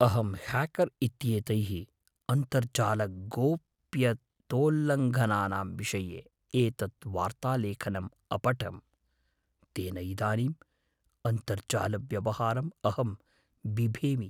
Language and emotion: Sanskrit, fearful